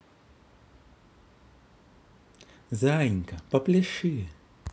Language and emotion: Russian, positive